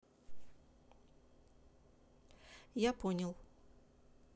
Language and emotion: Russian, neutral